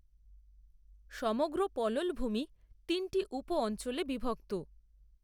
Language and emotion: Bengali, neutral